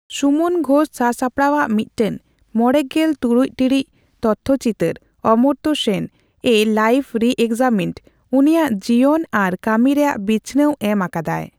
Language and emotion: Santali, neutral